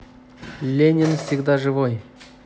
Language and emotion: Russian, positive